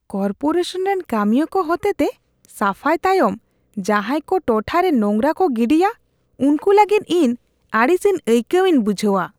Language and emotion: Santali, disgusted